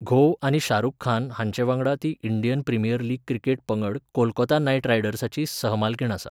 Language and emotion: Goan Konkani, neutral